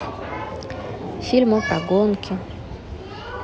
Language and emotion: Russian, neutral